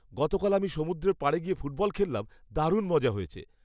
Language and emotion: Bengali, happy